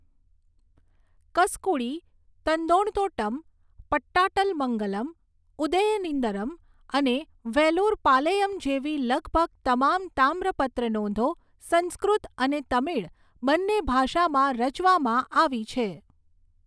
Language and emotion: Gujarati, neutral